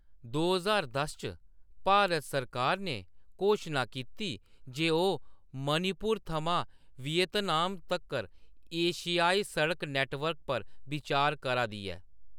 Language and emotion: Dogri, neutral